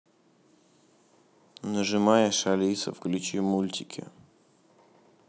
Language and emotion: Russian, neutral